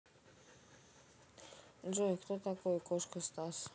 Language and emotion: Russian, neutral